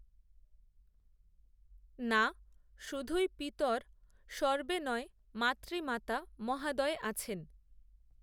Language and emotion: Bengali, neutral